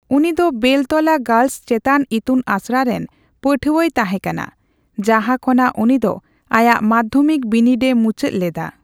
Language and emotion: Santali, neutral